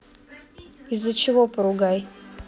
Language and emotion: Russian, neutral